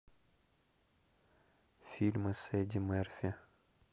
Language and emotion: Russian, neutral